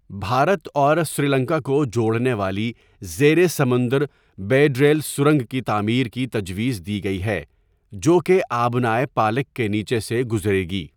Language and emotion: Urdu, neutral